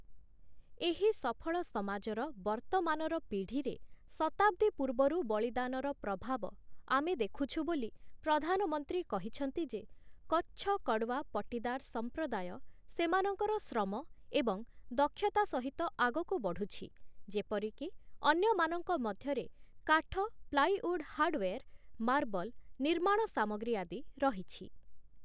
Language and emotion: Odia, neutral